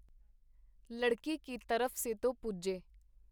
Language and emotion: Punjabi, neutral